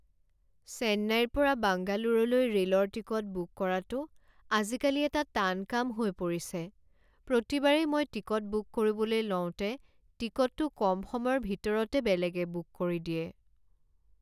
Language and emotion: Assamese, sad